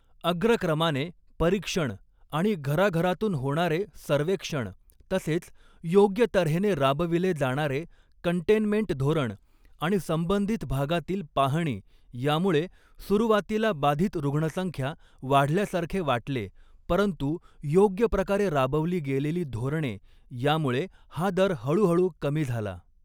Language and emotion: Marathi, neutral